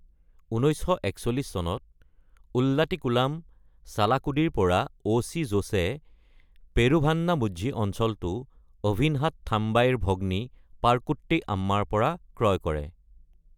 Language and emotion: Assamese, neutral